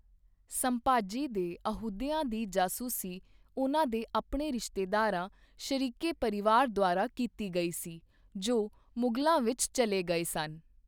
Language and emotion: Punjabi, neutral